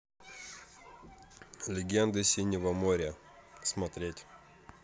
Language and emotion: Russian, neutral